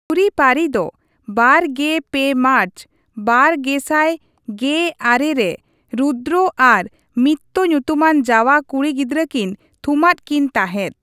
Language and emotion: Santali, neutral